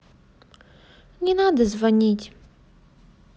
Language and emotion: Russian, sad